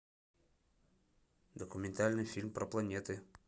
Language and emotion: Russian, neutral